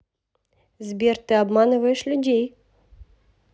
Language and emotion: Russian, neutral